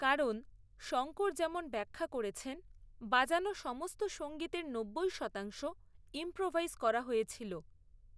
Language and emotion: Bengali, neutral